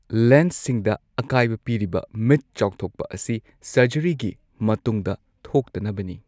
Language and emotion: Manipuri, neutral